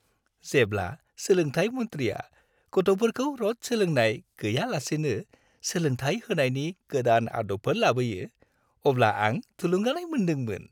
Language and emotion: Bodo, happy